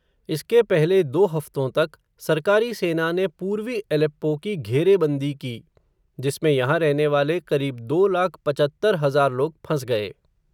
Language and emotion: Hindi, neutral